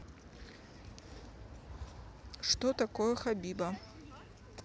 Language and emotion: Russian, neutral